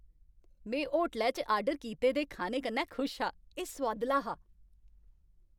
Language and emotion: Dogri, happy